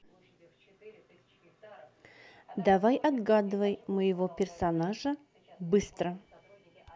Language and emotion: Russian, neutral